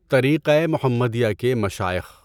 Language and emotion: Urdu, neutral